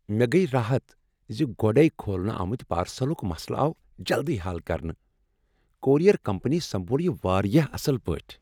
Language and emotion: Kashmiri, happy